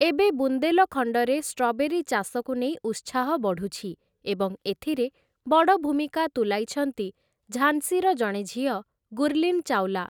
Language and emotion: Odia, neutral